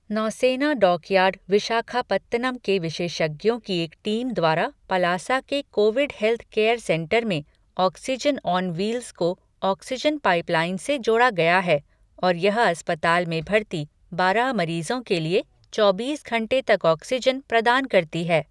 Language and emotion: Hindi, neutral